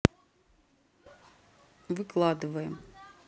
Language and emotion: Russian, neutral